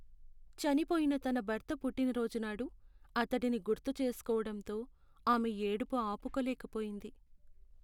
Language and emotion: Telugu, sad